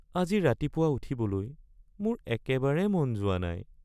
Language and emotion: Assamese, sad